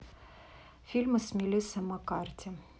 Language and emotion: Russian, neutral